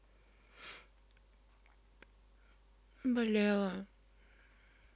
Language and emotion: Russian, sad